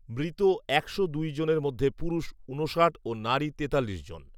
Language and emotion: Bengali, neutral